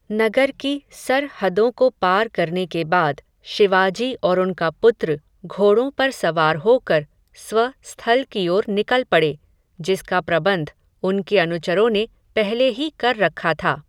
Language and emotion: Hindi, neutral